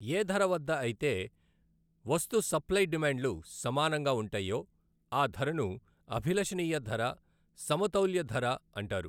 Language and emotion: Telugu, neutral